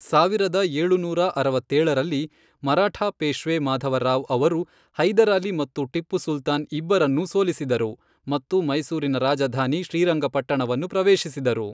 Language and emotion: Kannada, neutral